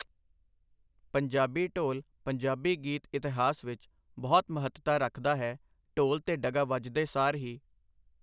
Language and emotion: Punjabi, neutral